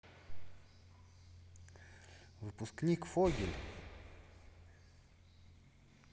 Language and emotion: Russian, neutral